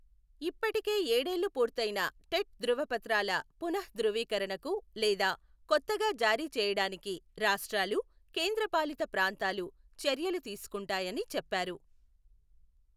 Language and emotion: Telugu, neutral